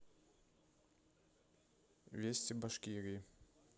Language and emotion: Russian, neutral